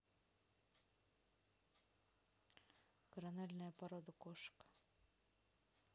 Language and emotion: Russian, neutral